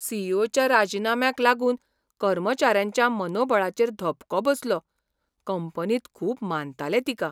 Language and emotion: Goan Konkani, surprised